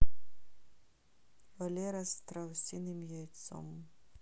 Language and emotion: Russian, neutral